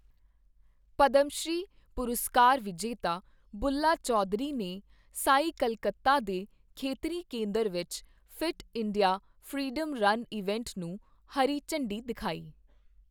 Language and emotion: Punjabi, neutral